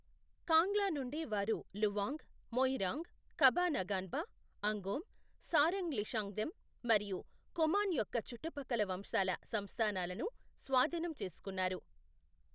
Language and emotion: Telugu, neutral